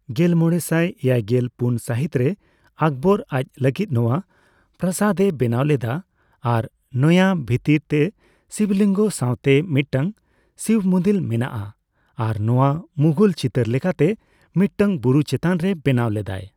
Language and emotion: Santali, neutral